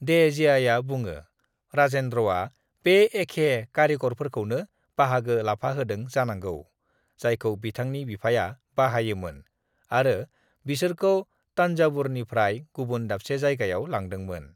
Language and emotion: Bodo, neutral